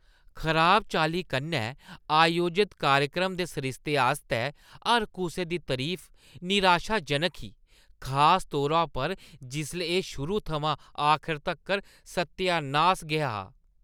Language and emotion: Dogri, disgusted